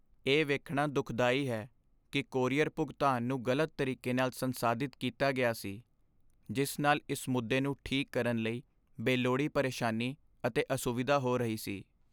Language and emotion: Punjabi, sad